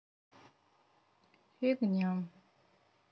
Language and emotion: Russian, sad